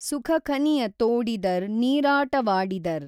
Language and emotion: Kannada, neutral